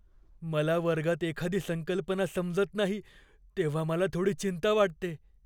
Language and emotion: Marathi, fearful